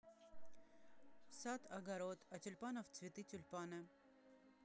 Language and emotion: Russian, neutral